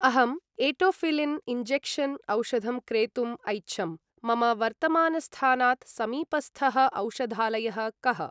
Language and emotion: Sanskrit, neutral